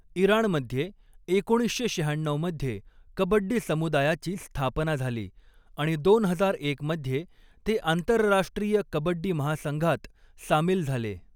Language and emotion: Marathi, neutral